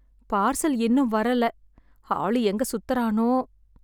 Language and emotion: Tamil, sad